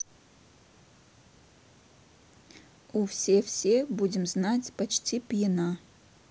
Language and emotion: Russian, neutral